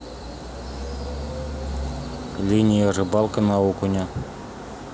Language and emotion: Russian, neutral